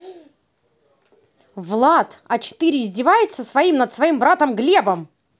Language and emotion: Russian, angry